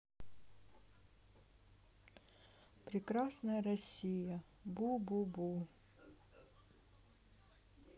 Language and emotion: Russian, sad